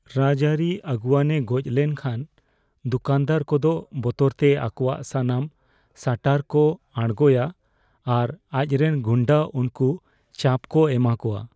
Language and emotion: Santali, fearful